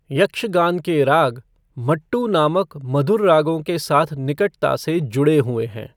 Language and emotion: Hindi, neutral